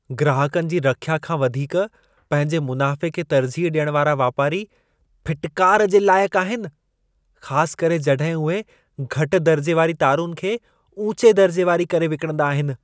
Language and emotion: Sindhi, disgusted